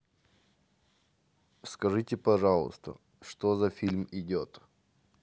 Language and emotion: Russian, neutral